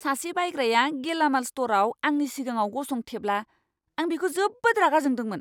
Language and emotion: Bodo, angry